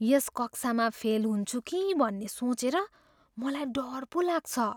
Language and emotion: Nepali, fearful